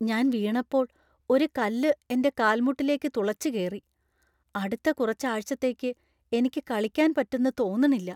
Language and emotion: Malayalam, fearful